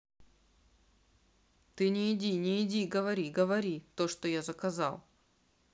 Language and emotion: Russian, neutral